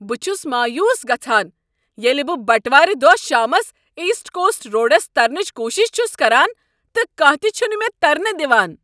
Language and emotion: Kashmiri, angry